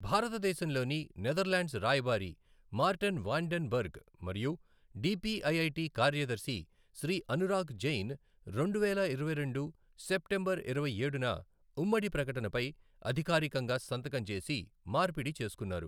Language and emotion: Telugu, neutral